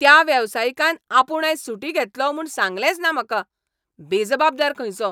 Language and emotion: Goan Konkani, angry